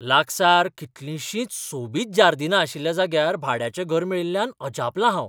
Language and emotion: Goan Konkani, surprised